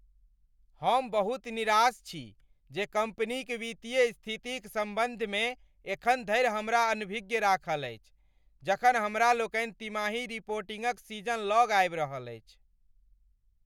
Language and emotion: Maithili, angry